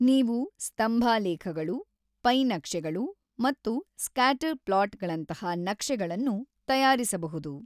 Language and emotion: Kannada, neutral